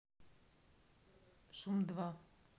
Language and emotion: Russian, neutral